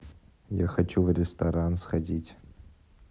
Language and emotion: Russian, neutral